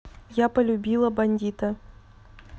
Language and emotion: Russian, neutral